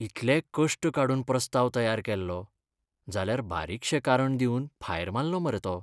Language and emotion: Goan Konkani, sad